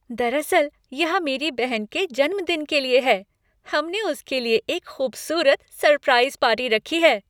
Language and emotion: Hindi, happy